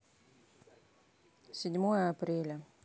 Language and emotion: Russian, neutral